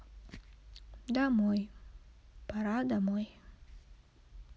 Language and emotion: Russian, sad